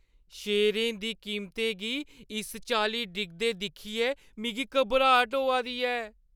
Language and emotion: Dogri, fearful